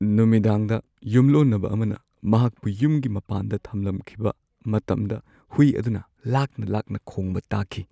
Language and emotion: Manipuri, sad